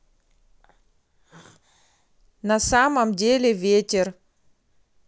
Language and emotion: Russian, neutral